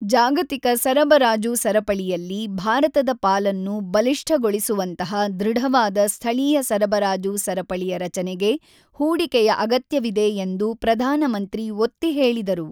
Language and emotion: Kannada, neutral